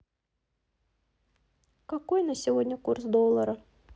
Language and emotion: Russian, neutral